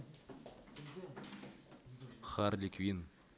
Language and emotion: Russian, neutral